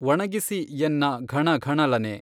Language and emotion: Kannada, neutral